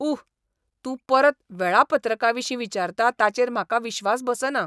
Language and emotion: Goan Konkani, disgusted